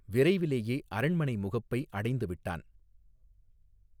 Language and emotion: Tamil, neutral